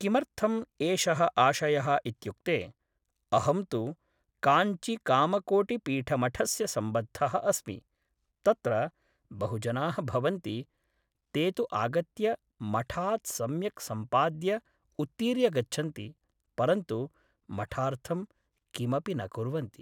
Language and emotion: Sanskrit, neutral